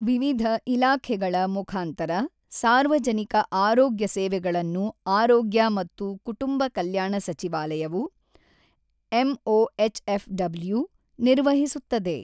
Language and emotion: Kannada, neutral